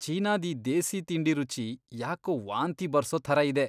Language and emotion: Kannada, disgusted